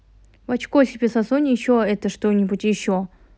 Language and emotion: Russian, angry